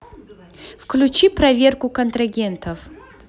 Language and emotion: Russian, neutral